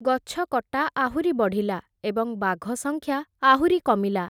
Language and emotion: Odia, neutral